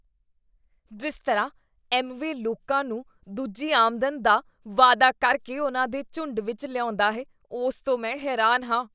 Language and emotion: Punjabi, disgusted